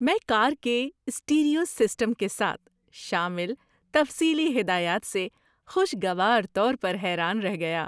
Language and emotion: Urdu, surprised